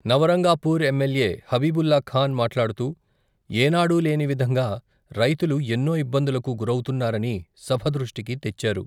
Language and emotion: Telugu, neutral